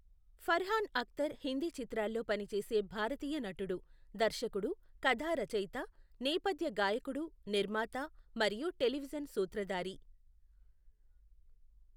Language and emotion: Telugu, neutral